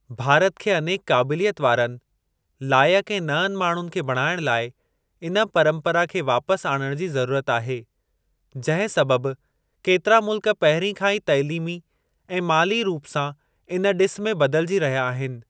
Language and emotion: Sindhi, neutral